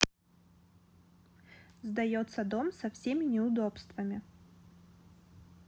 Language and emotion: Russian, neutral